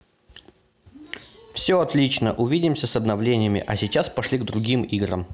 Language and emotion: Russian, positive